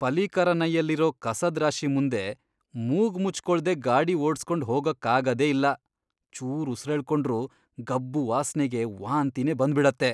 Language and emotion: Kannada, disgusted